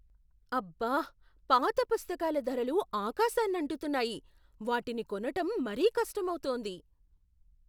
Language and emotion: Telugu, surprised